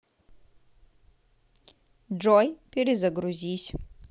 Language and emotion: Russian, neutral